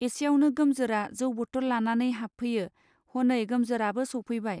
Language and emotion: Bodo, neutral